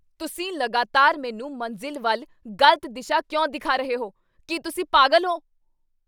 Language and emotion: Punjabi, angry